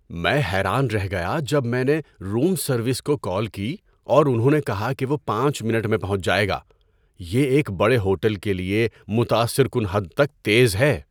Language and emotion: Urdu, surprised